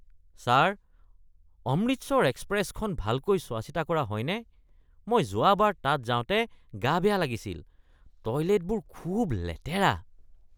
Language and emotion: Assamese, disgusted